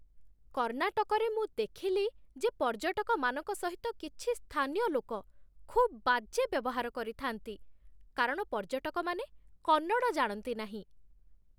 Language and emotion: Odia, disgusted